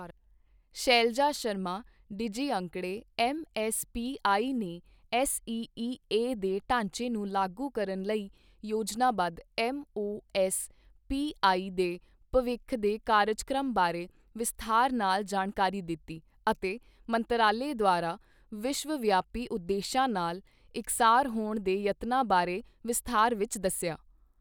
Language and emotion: Punjabi, neutral